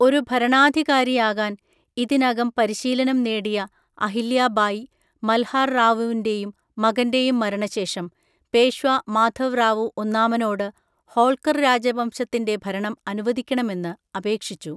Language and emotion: Malayalam, neutral